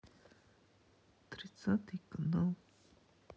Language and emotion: Russian, sad